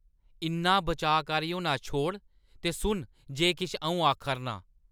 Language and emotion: Dogri, angry